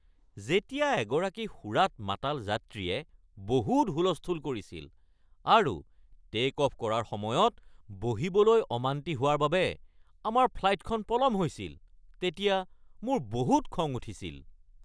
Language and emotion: Assamese, angry